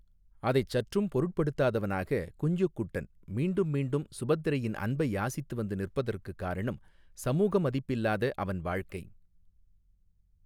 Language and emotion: Tamil, neutral